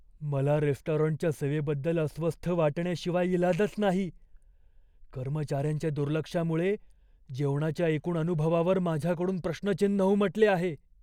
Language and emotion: Marathi, fearful